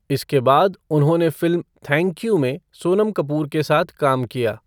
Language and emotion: Hindi, neutral